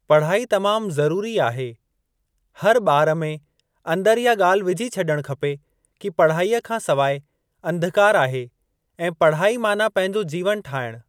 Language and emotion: Sindhi, neutral